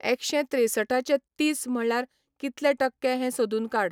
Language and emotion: Goan Konkani, neutral